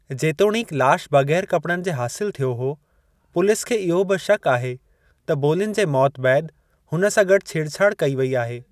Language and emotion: Sindhi, neutral